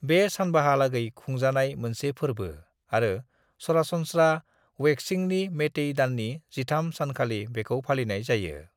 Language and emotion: Bodo, neutral